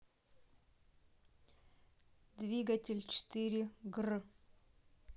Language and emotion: Russian, neutral